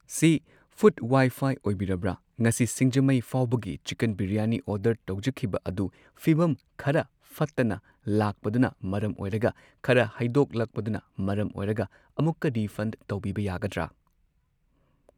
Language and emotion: Manipuri, neutral